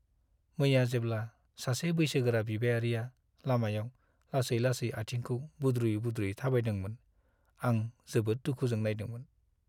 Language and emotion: Bodo, sad